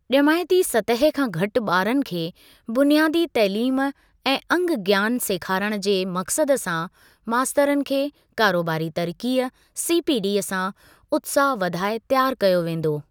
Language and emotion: Sindhi, neutral